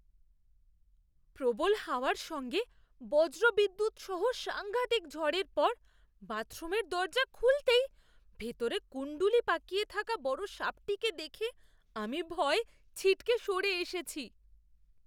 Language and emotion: Bengali, fearful